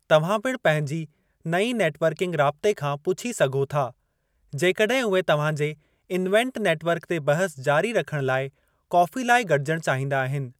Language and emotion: Sindhi, neutral